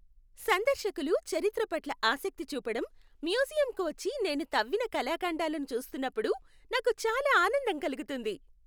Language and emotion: Telugu, happy